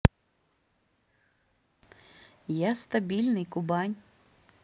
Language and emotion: Russian, neutral